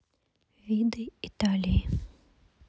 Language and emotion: Russian, neutral